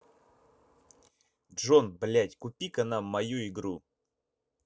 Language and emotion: Russian, angry